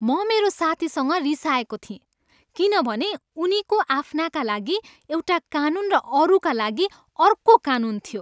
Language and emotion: Nepali, angry